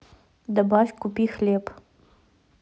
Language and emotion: Russian, neutral